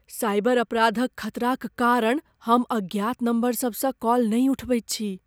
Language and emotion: Maithili, fearful